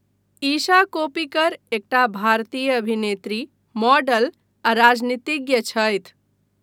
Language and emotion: Maithili, neutral